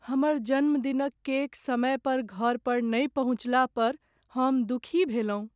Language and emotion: Maithili, sad